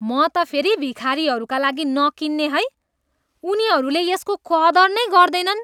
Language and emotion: Nepali, disgusted